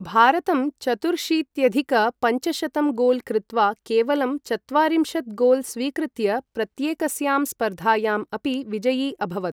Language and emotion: Sanskrit, neutral